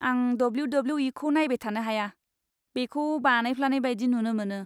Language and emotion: Bodo, disgusted